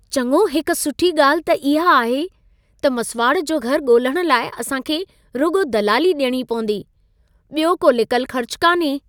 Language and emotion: Sindhi, happy